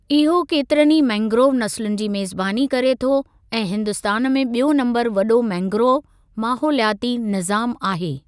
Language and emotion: Sindhi, neutral